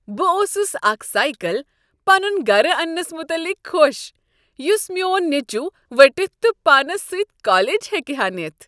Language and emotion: Kashmiri, happy